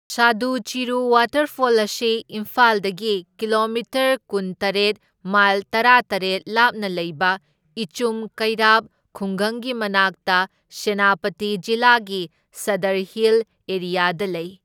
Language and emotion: Manipuri, neutral